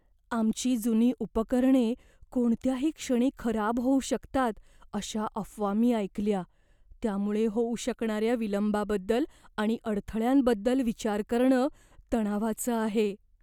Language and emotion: Marathi, fearful